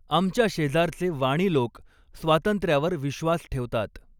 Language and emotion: Marathi, neutral